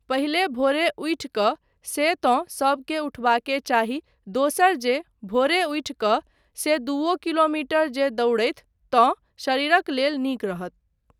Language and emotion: Maithili, neutral